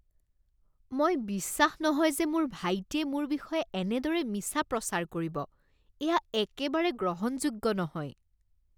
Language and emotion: Assamese, disgusted